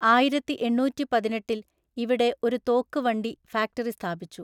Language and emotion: Malayalam, neutral